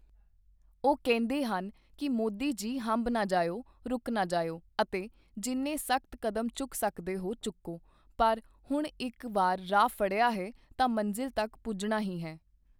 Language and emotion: Punjabi, neutral